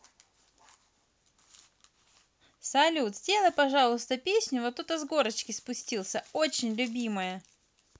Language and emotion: Russian, positive